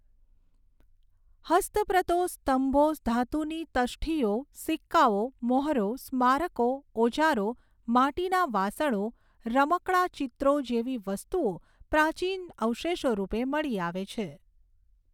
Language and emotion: Gujarati, neutral